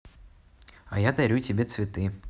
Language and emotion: Russian, neutral